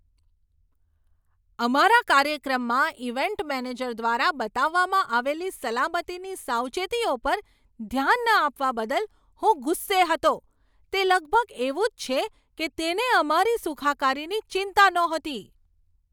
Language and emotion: Gujarati, angry